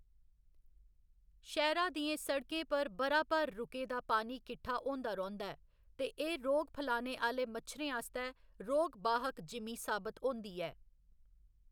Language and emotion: Dogri, neutral